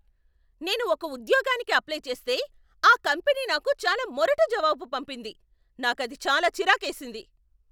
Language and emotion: Telugu, angry